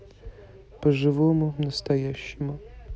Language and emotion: Russian, neutral